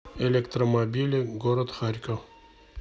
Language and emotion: Russian, neutral